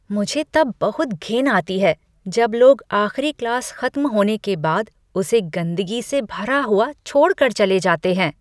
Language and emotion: Hindi, disgusted